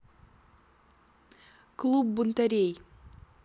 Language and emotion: Russian, neutral